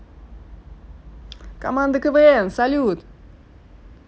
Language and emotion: Russian, positive